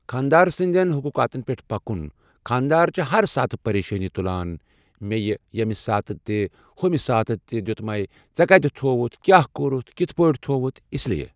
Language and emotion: Kashmiri, neutral